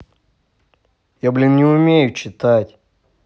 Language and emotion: Russian, angry